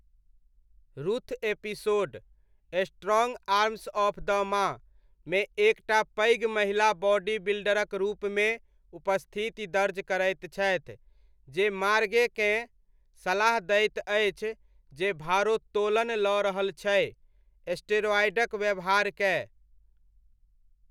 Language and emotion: Maithili, neutral